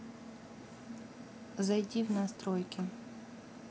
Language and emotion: Russian, neutral